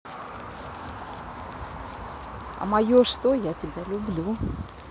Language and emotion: Russian, positive